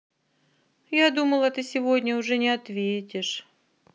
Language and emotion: Russian, sad